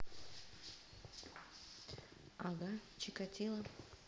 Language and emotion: Russian, neutral